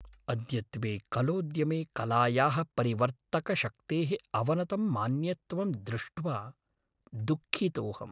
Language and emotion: Sanskrit, sad